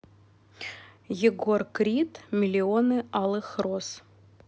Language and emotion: Russian, neutral